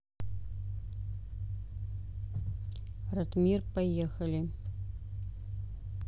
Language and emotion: Russian, neutral